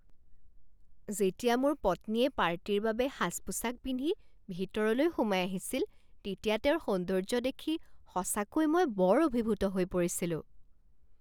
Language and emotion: Assamese, surprised